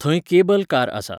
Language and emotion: Goan Konkani, neutral